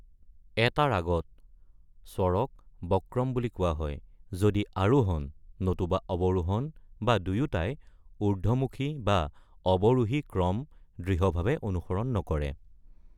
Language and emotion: Assamese, neutral